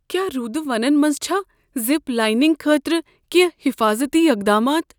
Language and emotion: Kashmiri, fearful